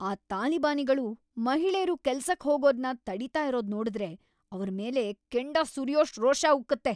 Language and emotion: Kannada, angry